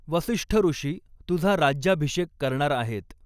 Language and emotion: Marathi, neutral